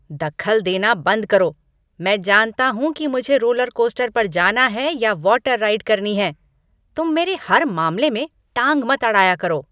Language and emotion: Hindi, angry